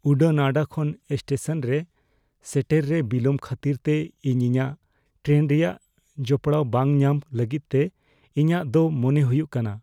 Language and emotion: Santali, fearful